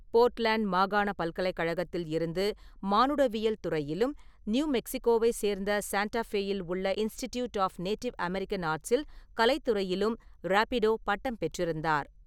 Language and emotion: Tamil, neutral